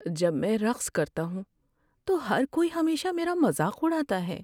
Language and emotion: Urdu, sad